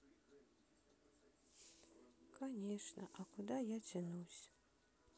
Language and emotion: Russian, sad